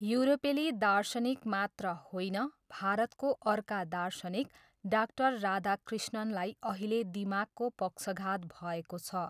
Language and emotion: Nepali, neutral